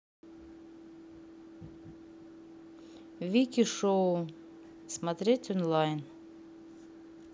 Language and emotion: Russian, neutral